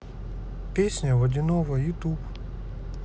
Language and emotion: Russian, neutral